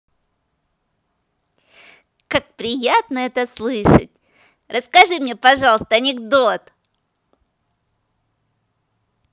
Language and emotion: Russian, positive